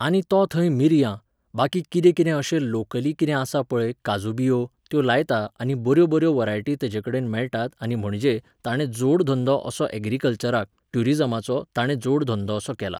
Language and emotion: Goan Konkani, neutral